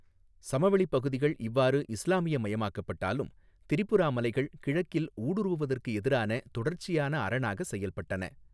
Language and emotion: Tamil, neutral